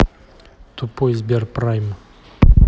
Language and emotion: Russian, angry